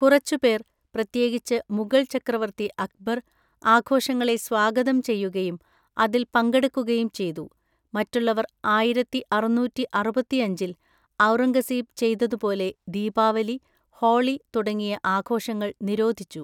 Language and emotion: Malayalam, neutral